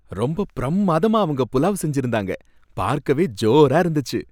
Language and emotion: Tamil, happy